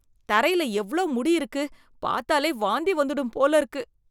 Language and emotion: Tamil, disgusted